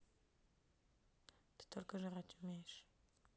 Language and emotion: Russian, neutral